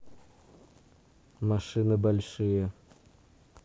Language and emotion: Russian, neutral